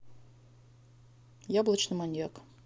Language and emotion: Russian, neutral